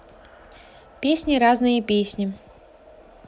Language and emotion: Russian, neutral